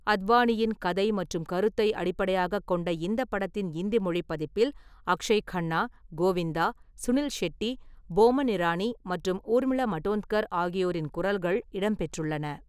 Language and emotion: Tamil, neutral